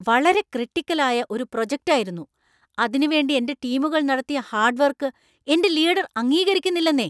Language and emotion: Malayalam, angry